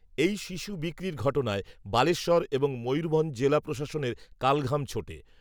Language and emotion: Bengali, neutral